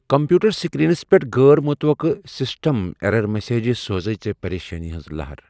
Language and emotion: Kashmiri, fearful